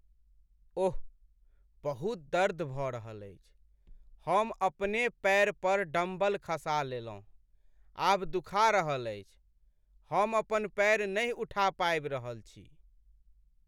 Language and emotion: Maithili, sad